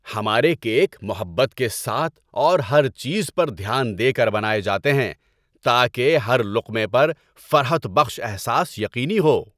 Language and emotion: Urdu, happy